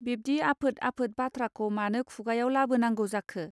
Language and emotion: Bodo, neutral